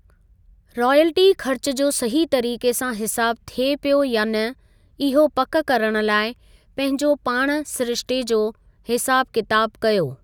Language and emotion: Sindhi, neutral